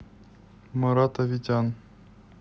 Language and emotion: Russian, neutral